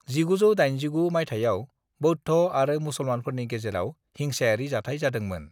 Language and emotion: Bodo, neutral